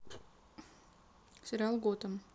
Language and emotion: Russian, neutral